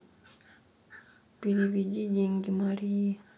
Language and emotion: Russian, sad